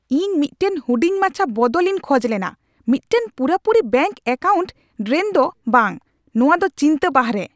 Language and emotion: Santali, angry